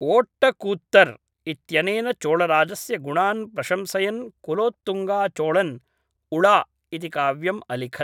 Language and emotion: Sanskrit, neutral